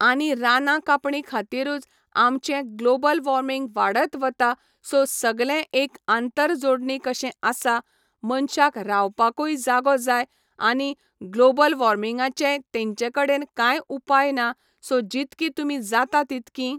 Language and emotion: Goan Konkani, neutral